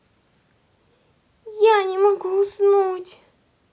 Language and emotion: Russian, sad